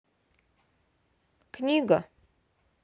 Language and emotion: Russian, neutral